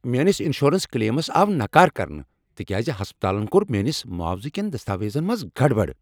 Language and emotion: Kashmiri, angry